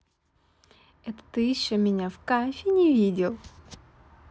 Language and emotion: Russian, positive